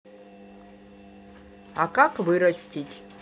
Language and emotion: Russian, neutral